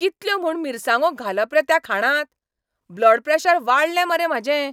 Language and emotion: Goan Konkani, angry